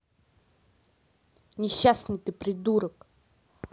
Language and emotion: Russian, angry